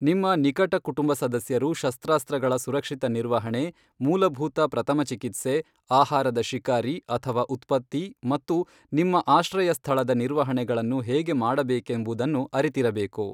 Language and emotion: Kannada, neutral